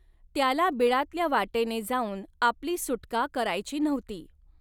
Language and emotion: Marathi, neutral